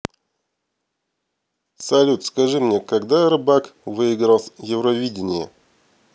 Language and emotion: Russian, neutral